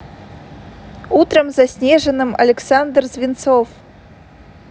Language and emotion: Russian, neutral